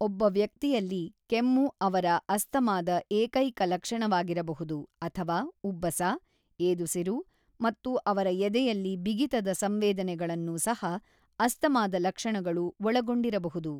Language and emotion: Kannada, neutral